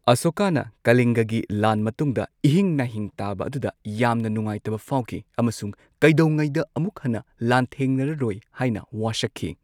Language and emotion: Manipuri, neutral